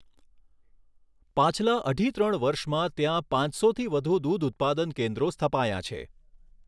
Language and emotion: Gujarati, neutral